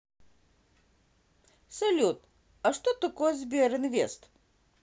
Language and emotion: Russian, positive